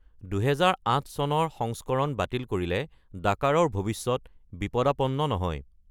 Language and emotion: Assamese, neutral